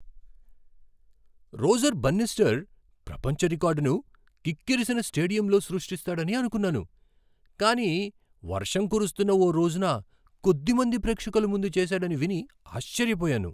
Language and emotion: Telugu, surprised